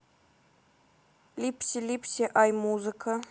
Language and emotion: Russian, neutral